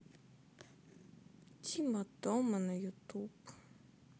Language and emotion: Russian, sad